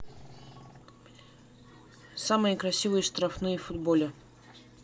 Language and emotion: Russian, neutral